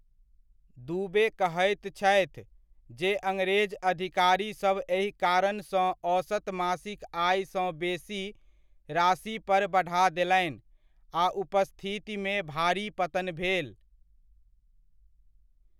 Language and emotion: Maithili, neutral